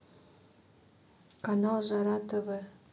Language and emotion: Russian, neutral